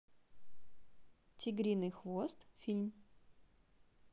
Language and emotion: Russian, neutral